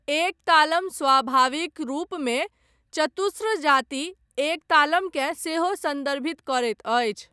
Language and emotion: Maithili, neutral